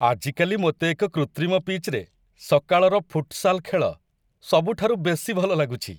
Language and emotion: Odia, happy